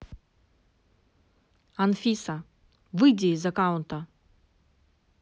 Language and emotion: Russian, angry